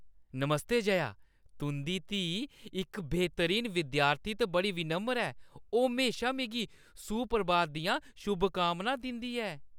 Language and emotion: Dogri, happy